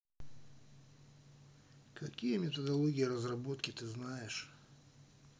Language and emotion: Russian, neutral